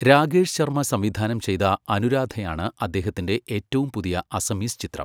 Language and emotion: Malayalam, neutral